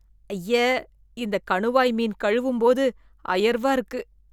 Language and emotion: Tamil, disgusted